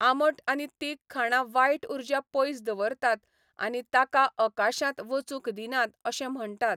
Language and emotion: Goan Konkani, neutral